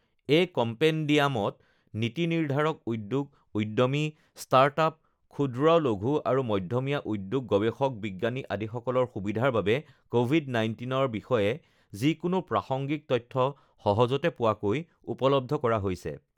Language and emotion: Assamese, neutral